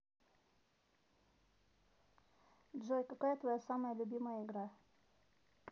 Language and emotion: Russian, neutral